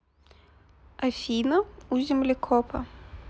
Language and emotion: Russian, neutral